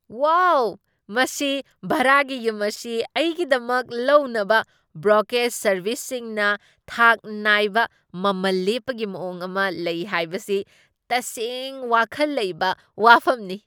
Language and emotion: Manipuri, surprised